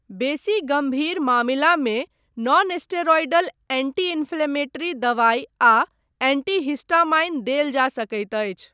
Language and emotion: Maithili, neutral